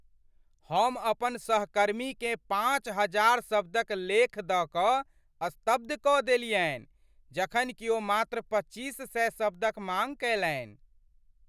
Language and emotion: Maithili, surprised